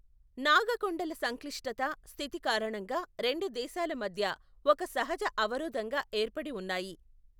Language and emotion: Telugu, neutral